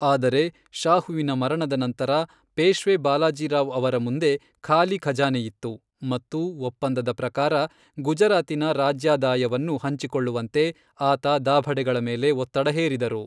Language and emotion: Kannada, neutral